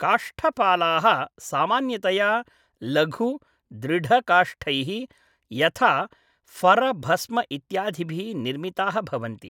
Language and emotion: Sanskrit, neutral